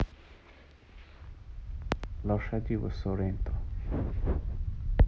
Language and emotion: Russian, neutral